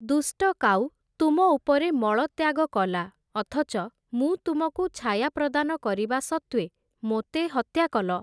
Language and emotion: Odia, neutral